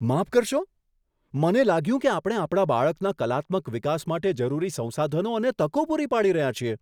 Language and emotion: Gujarati, surprised